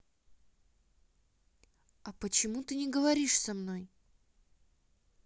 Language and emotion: Russian, neutral